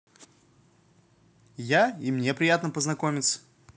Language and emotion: Russian, positive